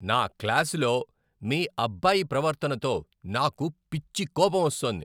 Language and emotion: Telugu, angry